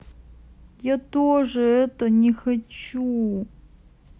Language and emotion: Russian, sad